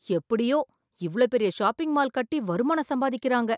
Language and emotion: Tamil, surprised